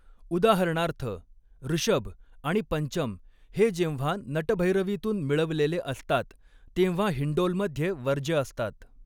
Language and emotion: Marathi, neutral